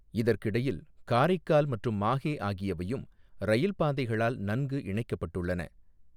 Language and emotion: Tamil, neutral